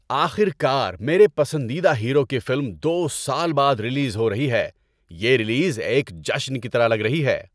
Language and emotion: Urdu, happy